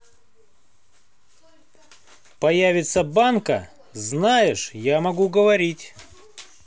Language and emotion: Russian, angry